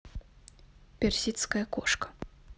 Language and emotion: Russian, neutral